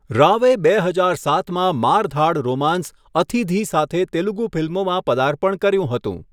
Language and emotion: Gujarati, neutral